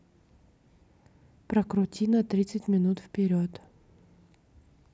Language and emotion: Russian, neutral